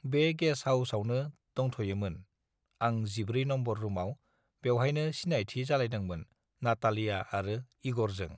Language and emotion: Bodo, neutral